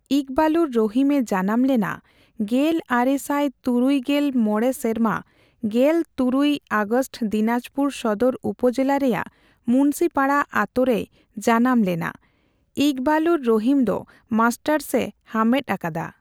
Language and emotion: Santali, neutral